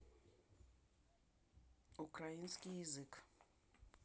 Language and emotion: Russian, neutral